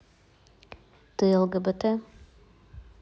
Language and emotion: Russian, neutral